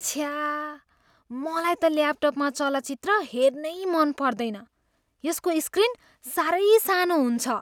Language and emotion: Nepali, disgusted